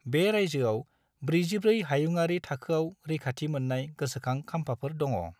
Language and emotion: Bodo, neutral